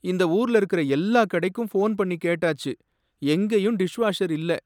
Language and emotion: Tamil, sad